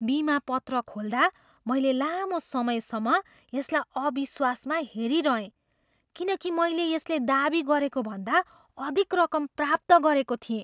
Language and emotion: Nepali, surprised